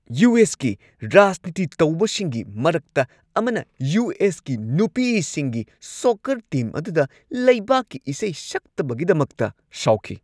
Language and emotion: Manipuri, angry